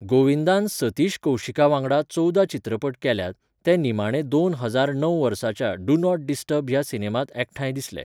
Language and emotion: Goan Konkani, neutral